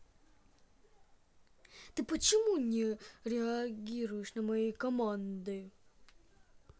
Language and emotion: Russian, angry